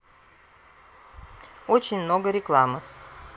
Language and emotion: Russian, neutral